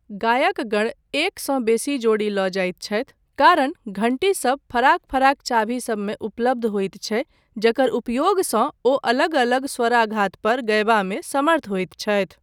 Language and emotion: Maithili, neutral